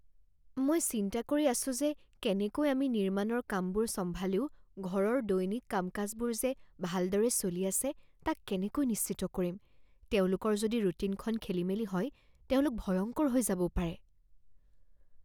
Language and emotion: Assamese, fearful